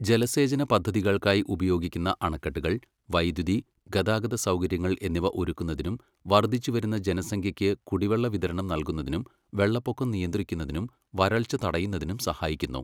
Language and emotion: Malayalam, neutral